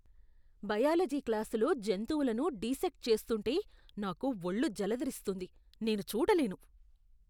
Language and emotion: Telugu, disgusted